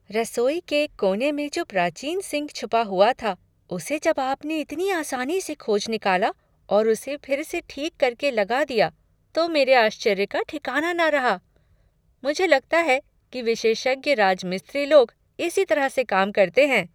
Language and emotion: Hindi, surprised